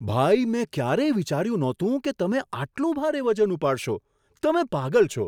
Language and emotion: Gujarati, surprised